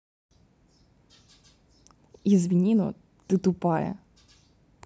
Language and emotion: Russian, neutral